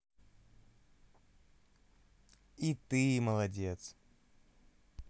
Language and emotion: Russian, positive